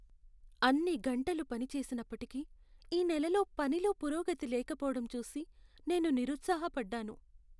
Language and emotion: Telugu, sad